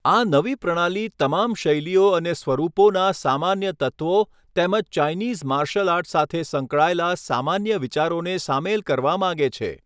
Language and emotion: Gujarati, neutral